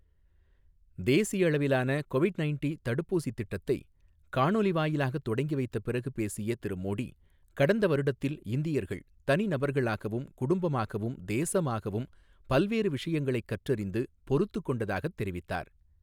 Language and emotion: Tamil, neutral